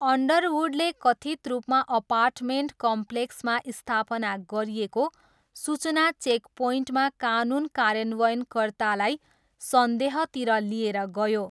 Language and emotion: Nepali, neutral